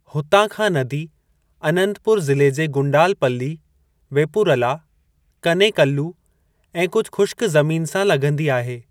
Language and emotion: Sindhi, neutral